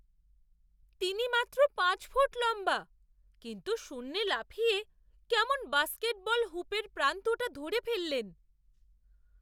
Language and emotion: Bengali, surprised